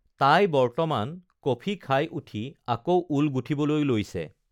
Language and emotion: Assamese, neutral